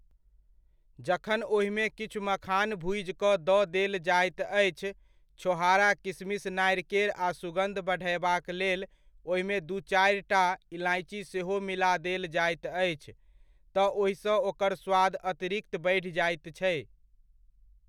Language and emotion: Maithili, neutral